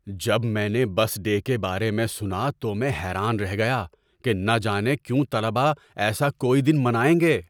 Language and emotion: Urdu, surprised